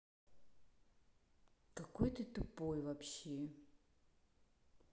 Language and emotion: Russian, angry